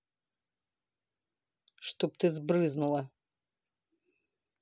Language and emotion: Russian, angry